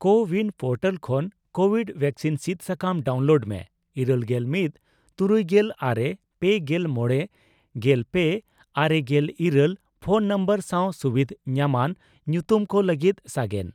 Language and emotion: Santali, neutral